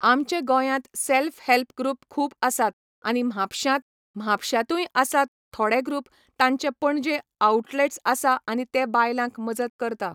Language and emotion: Goan Konkani, neutral